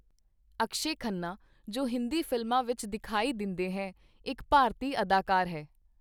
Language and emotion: Punjabi, neutral